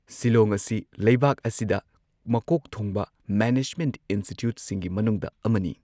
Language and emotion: Manipuri, neutral